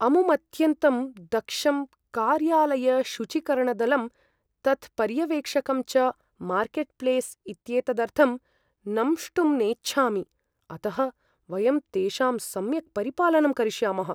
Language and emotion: Sanskrit, fearful